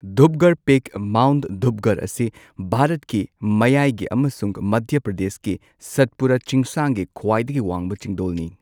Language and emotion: Manipuri, neutral